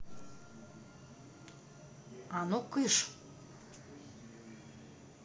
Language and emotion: Russian, angry